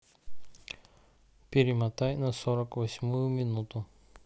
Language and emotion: Russian, neutral